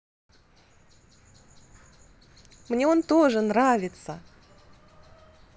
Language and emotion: Russian, positive